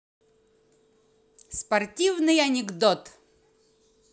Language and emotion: Russian, positive